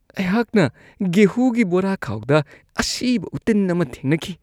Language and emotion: Manipuri, disgusted